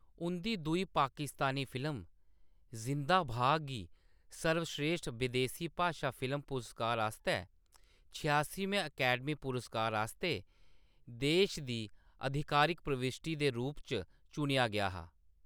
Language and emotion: Dogri, neutral